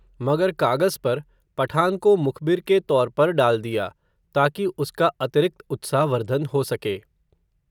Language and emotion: Hindi, neutral